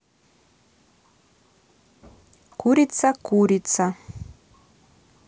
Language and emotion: Russian, neutral